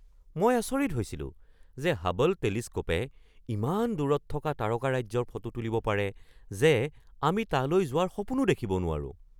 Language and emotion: Assamese, surprised